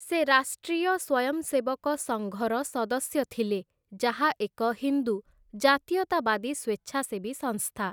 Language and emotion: Odia, neutral